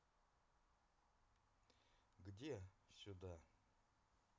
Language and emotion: Russian, neutral